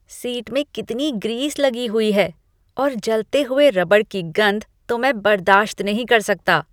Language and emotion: Hindi, disgusted